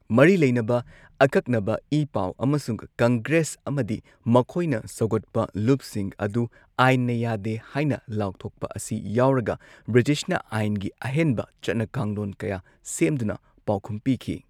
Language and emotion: Manipuri, neutral